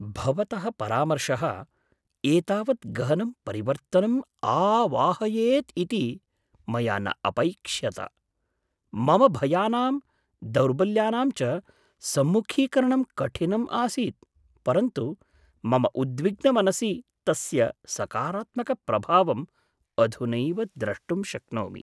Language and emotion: Sanskrit, surprised